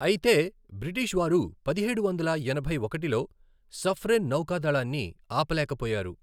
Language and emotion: Telugu, neutral